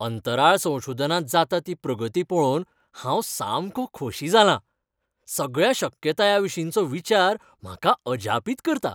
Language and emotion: Goan Konkani, happy